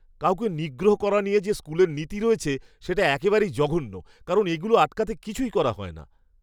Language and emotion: Bengali, disgusted